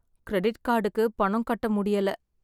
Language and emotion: Tamil, sad